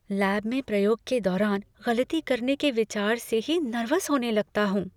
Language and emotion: Hindi, fearful